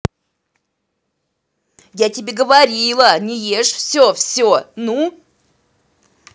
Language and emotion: Russian, angry